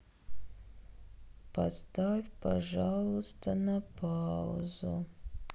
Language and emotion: Russian, sad